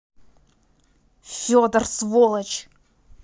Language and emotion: Russian, angry